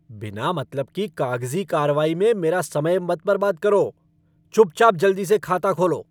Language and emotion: Hindi, angry